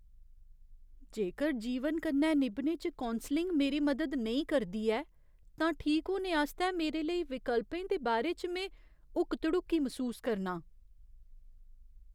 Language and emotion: Dogri, fearful